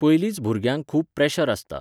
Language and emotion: Goan Konkani, neutral